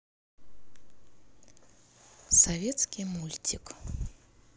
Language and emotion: Russian, neutral